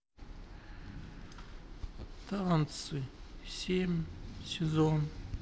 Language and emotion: Russian, sad